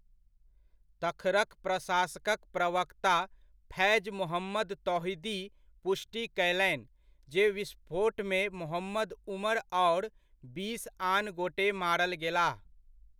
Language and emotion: Maithili, neutral